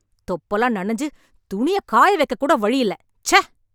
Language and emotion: Tamil, angry